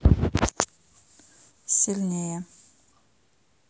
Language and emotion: Russian, neutral